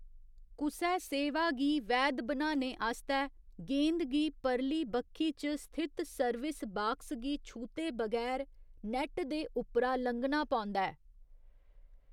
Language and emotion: Dogri, neutral